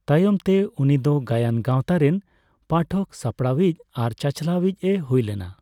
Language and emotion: Santali, neutral